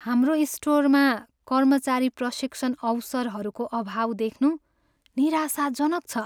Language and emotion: Nepali, sad